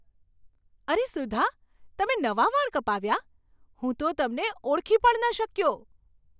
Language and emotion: Gujarati, surprised